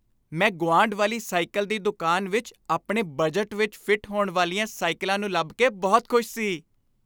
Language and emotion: Punjabi, happy